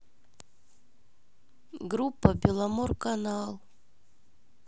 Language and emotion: Russian, sad